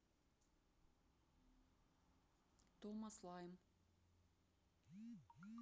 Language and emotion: Russian, neutral